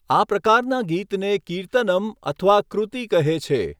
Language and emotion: Gujarati, neutral